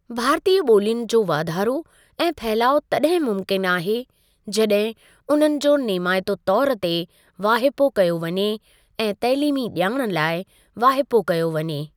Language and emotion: Sindhi, neutral